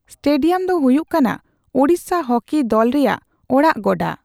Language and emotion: Santali, neutral